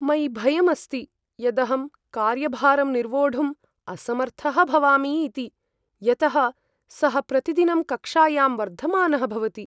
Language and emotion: Sanskrit, fearful